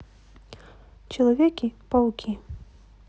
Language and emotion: Russian, neutral